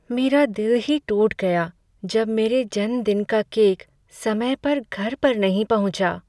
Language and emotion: Hindi, sad